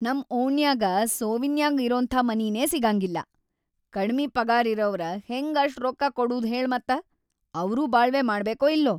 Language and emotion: Kannada, angry